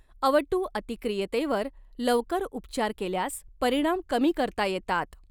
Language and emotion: Marathi, neutral